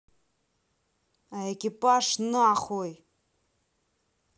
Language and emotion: Russian, angry